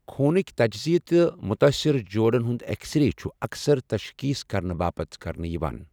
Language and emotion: Kashmiri, neutral